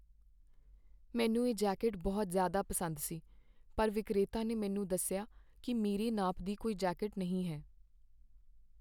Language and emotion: Punjabi, sad